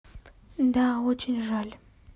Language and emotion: Russian, sad